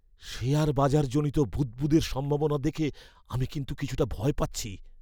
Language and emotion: Bengali, fearful